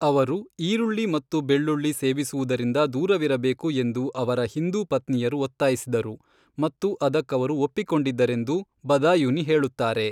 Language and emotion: Kannada, neutral